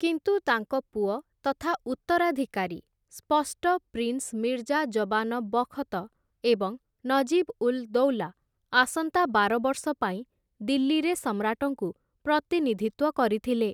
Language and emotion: Odia, neutral